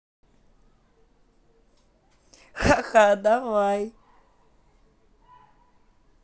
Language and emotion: Russian, positive